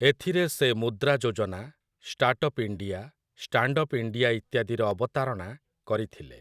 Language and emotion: Odia, neutral